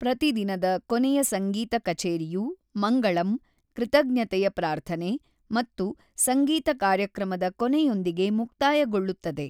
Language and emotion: Kannada, neutral